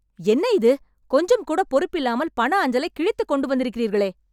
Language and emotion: Tamil, angry